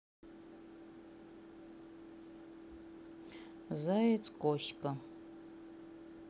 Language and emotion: Russian, neutral